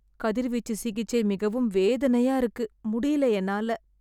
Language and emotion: Tamil, sad